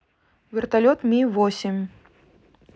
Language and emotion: Russian, neutral